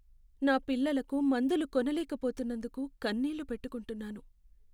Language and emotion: Telugu, sad